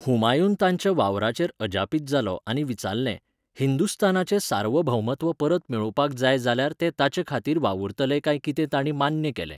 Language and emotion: Goan Konkani, neutral